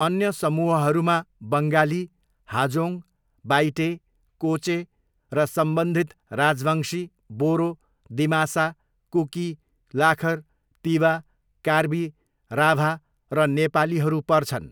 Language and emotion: Nepali, neutral